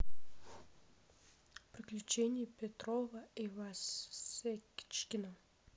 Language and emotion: Russian, neutral